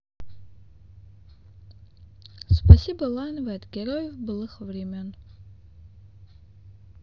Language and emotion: Russian, sad